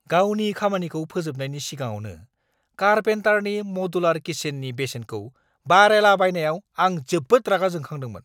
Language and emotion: Bodo, angry